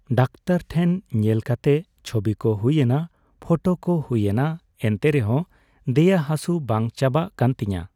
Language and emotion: Santali, neutral